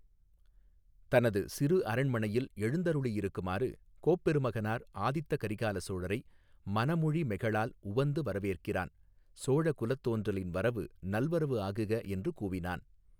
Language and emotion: Tamil, neutral